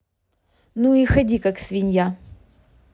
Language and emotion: Russian, angry